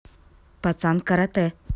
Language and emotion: Russian, neutral